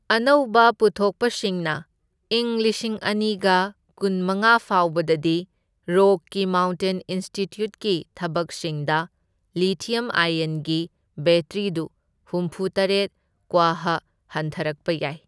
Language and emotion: Manipuri, neutral